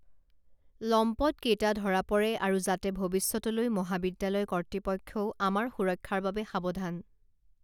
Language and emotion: Assamese, neutral